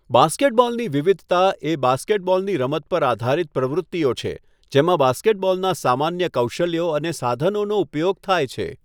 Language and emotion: Gujarati, neutral